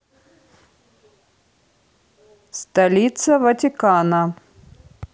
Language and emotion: Russian, neutral